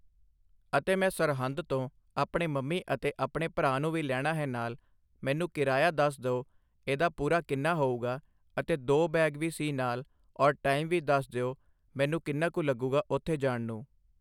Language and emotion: Punjabi, neutral